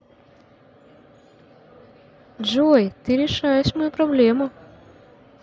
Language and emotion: Russian, positive